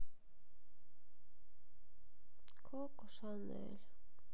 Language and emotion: Russian, sad